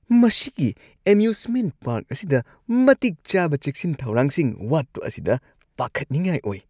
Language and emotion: Manipuri, disgusted